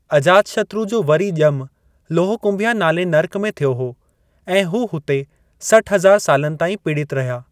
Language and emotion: Sindhi, neutral